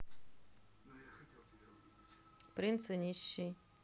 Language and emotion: Russian, neutral